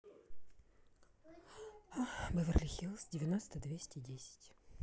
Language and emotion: Russian, sad